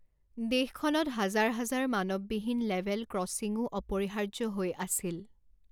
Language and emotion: Assamese, neutral